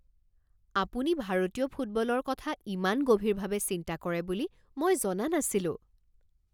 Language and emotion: Assamese, surprised